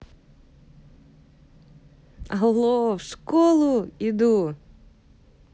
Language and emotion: Russian, positive